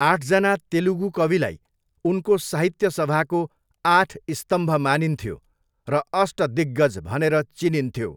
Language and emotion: Nepali, neutral